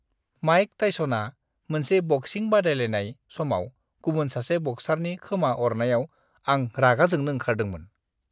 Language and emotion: Bodo, disgusted